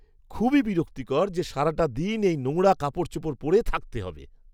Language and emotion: Bengali, disgusted